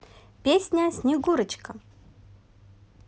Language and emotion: Russian, positive